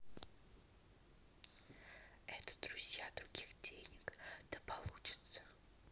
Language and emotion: Russian, neutral